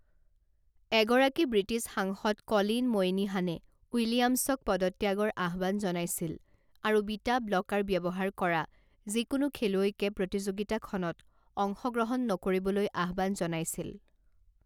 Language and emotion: Assamese, neutral